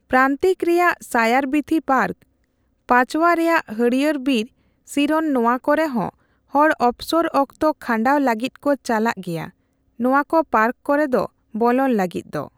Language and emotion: Santali, neutral